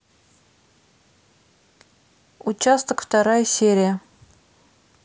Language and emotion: Russian, neutral